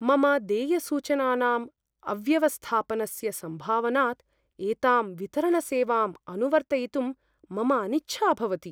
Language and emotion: Sanskrit, fearful